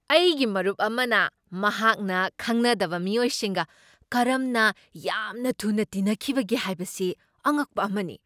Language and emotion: Manipuri, surprised